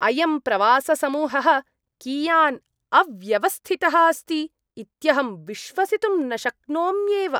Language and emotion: Sanskrit, disgusted